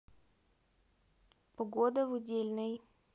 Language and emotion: Russian, neutral